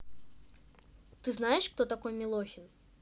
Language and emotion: Russian, neutral